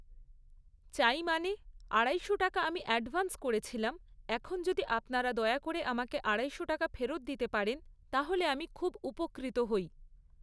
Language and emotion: Bengali, neutral